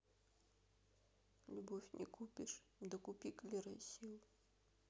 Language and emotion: Russian, sad